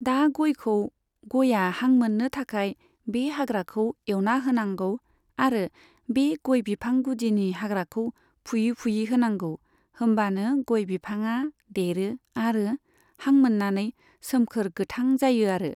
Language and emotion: Bodo, neutral